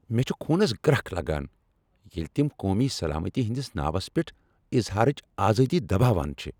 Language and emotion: Kashmiri, angry